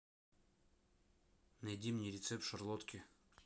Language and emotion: Russian, neutral